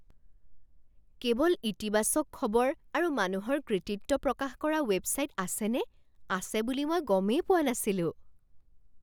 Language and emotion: Assamese, surprised